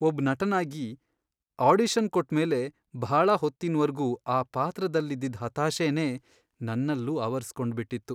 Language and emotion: Kannada, sad